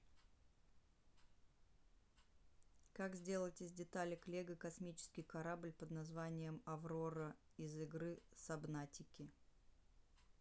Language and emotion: Russian, neutral